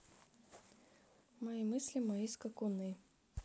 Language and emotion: Russian, neutral